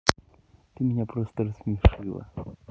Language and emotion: Russian, neutral